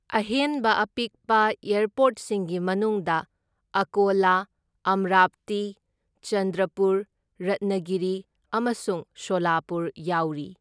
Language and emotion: Manipuri, neutral